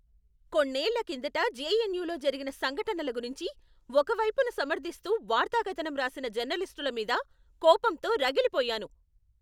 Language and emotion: Telugu, angry